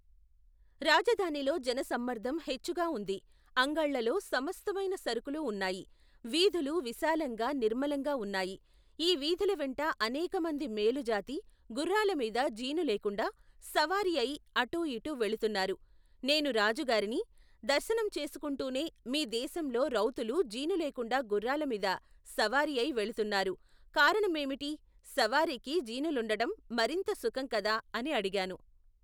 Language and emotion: Telugu, neutral